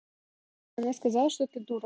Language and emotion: Russian, neutral